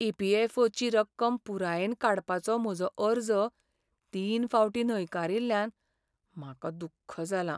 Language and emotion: Goan Konkani, sad